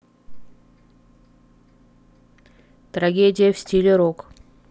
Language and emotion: Russian, neutral